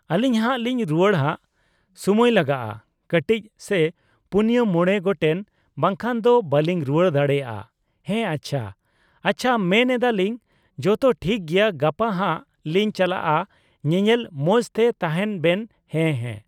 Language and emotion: Santali, neutral